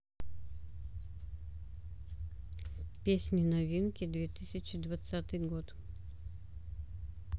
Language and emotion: Russian, neutral